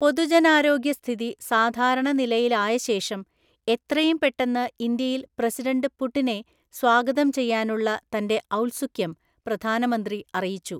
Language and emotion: Malayalam, neutral